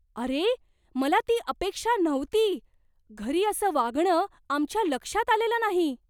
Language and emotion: Marathi, surprised